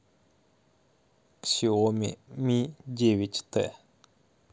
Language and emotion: Russian, neutral